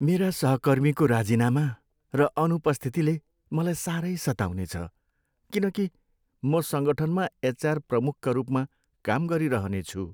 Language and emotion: Nepali, sad